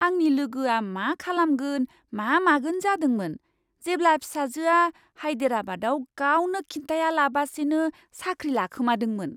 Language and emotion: Bodo, surprised